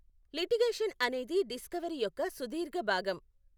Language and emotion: Telugu, neutral